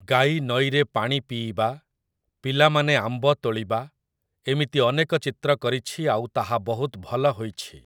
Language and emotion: Odia, neutral